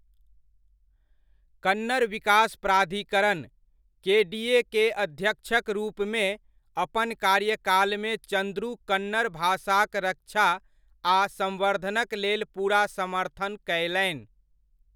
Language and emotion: Maithili, neutral